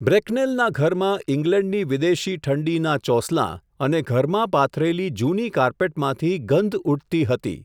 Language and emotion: Gujarati, neutral